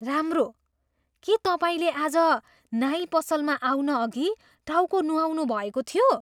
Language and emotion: Nepali, surprised